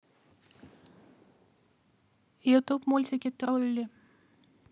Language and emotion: Russian, neutral